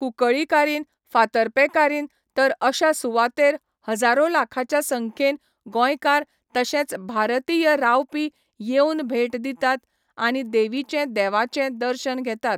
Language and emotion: Goan Konkani, neutral